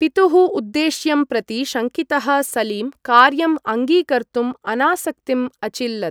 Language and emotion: Sanskrit, neutral